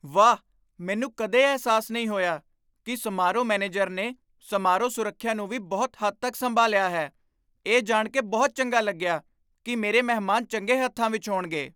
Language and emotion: Punjabi, surprised